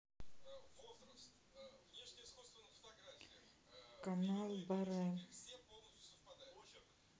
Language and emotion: Russian, neutral